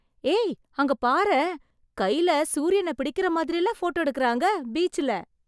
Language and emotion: Tamil, surprised